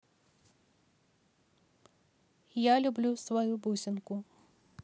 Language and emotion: Russian, neutral